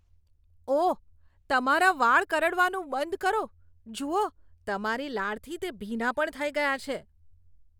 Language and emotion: Gujarati, disgusted